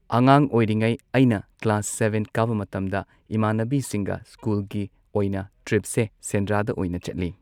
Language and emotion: Manipuri, neutral